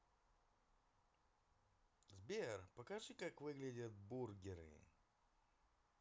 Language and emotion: Russian, positive